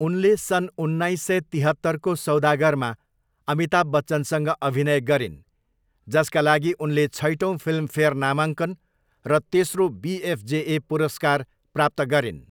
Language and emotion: Nepali, neutral